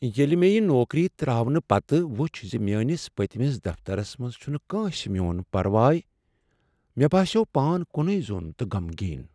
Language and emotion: Kashmiri, sad